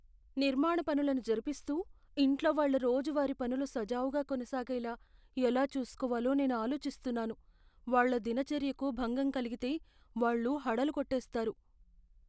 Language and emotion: Telugu, fearful